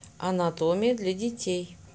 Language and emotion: Russian, neutral